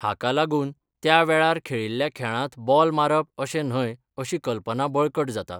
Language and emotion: Goan Konkani, neutral